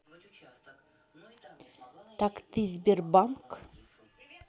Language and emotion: Russian, neutral